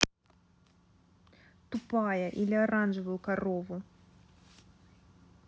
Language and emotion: Russian, angry